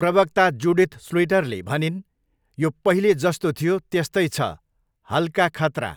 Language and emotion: Nepali, neutral